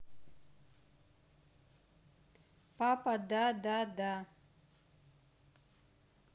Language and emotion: Russian, neutral